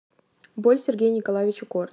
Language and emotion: Russian, neutral